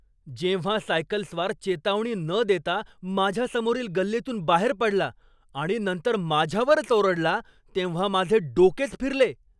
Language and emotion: Marathi, angry